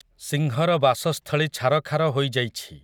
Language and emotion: Odia, neutral